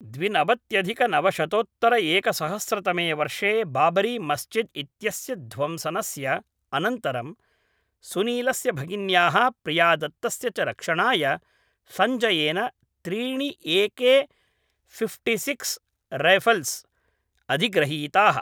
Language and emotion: Sanskrit, neutral